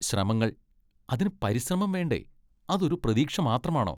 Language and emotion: Malayalam, disgusted